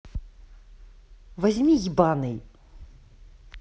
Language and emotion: Russian, angry